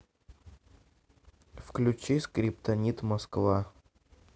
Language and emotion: Russian, neutral